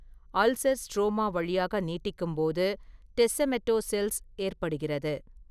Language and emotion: Tamil, neutral